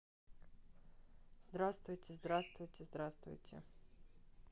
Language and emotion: Russian, neutral